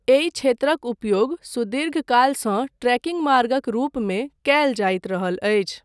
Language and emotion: Maithili, neutral